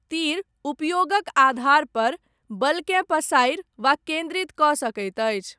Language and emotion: Maithili, neutral